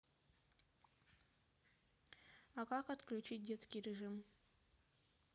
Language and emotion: Russian, neutral